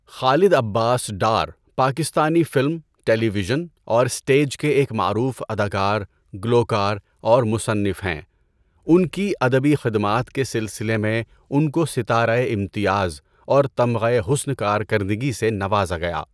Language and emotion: Urdu, neutral